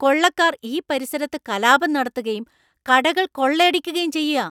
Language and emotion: Malayalam, angry